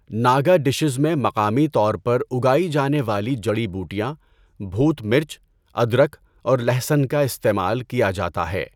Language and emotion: Urdu, neutral